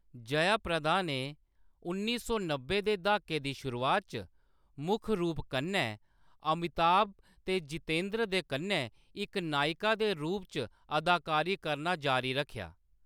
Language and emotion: Dogri, neutral